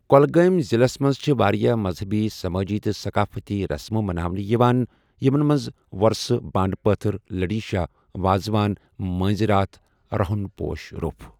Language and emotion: Kashmiri, neutral